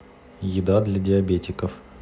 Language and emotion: Russian, neutral